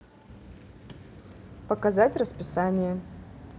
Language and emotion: Russian, neutral